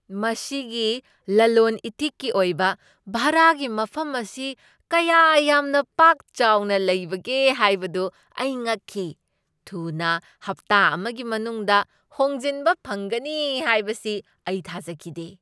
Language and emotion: Manipuri, surprised